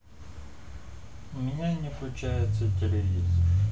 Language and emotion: Russian, sad